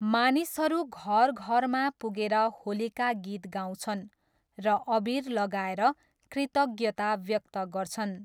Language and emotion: Nepali, neutral